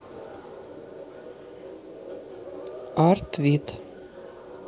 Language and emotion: Russian, neutral